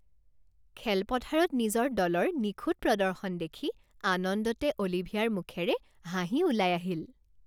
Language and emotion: Assamese, happy